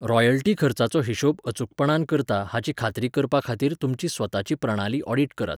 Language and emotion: Goan Konkani, neutral